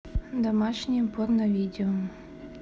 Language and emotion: Russian, neutral